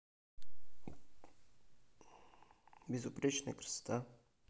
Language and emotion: Russian, neutral